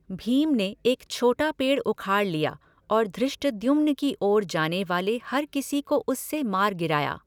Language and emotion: Hindi, neutral